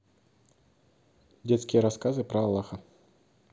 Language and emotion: Russian, neutral